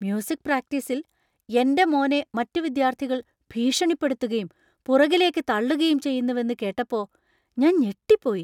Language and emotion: Malayalam, surprised